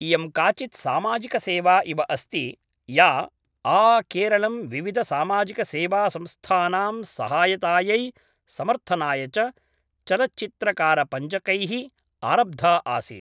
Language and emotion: Sanskrit, neutral